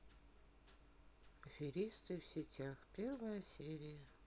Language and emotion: Russian, sad